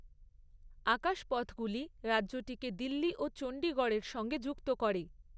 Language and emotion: Bengali, neutral